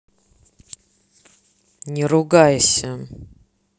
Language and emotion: Russian, angry